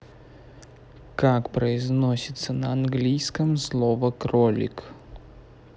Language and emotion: Russian, neutral